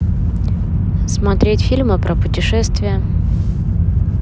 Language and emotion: Russian, neutral